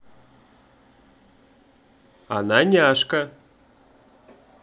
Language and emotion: Russian, positive